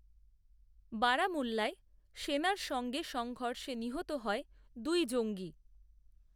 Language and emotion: Bengali, neutral